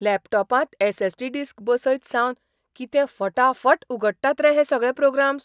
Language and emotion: Goan Konkani, surprised